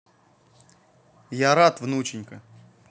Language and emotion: Russian, positive